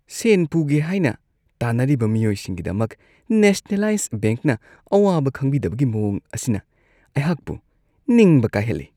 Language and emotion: Manipuri, disgusted